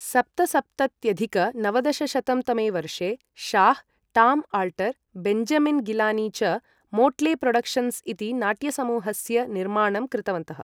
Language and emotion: Sanskrit, neutral